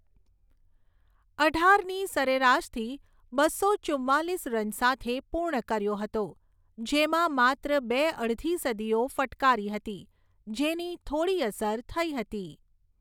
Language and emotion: Gujarati, neutral